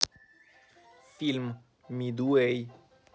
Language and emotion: Russian, neutral